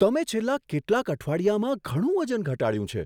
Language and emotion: Gujarati, surprised